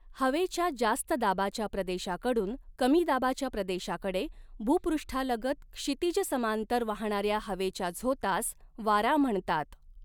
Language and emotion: Marathi, neutral